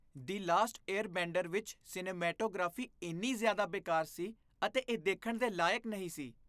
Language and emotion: Punjabi, disgusted